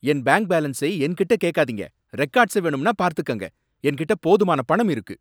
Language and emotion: Tamil, angry